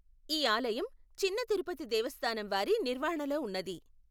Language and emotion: Telugu, neutral